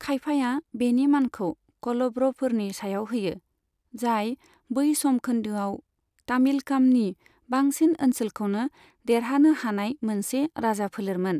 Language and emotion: Bodo, neutral